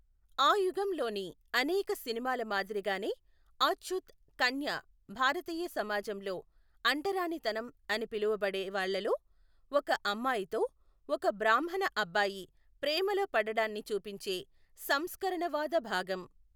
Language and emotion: Telugu, neutral